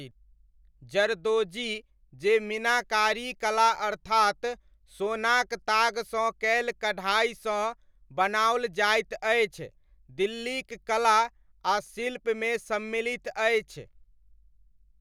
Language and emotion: Maithili, neutral